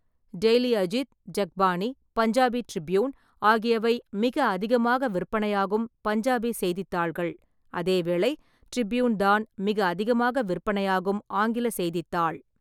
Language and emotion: Tamil, neutral